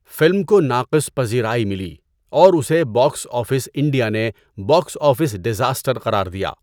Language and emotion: Urdu, neutral